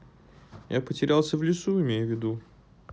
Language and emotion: Russian, sad